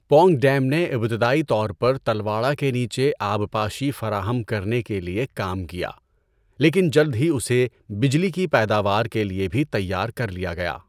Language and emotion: Urdu, neutral